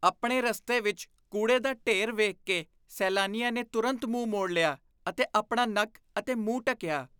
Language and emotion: Punjabi, disgusted